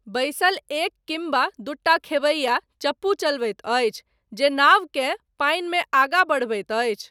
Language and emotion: Maithili, neutral